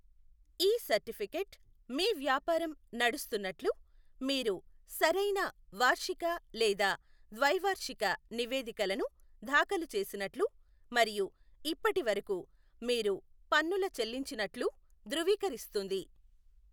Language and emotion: Telugu, neutral